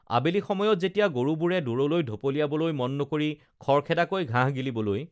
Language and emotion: Assamese, neutral